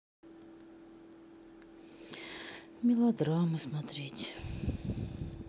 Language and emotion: Russian, sad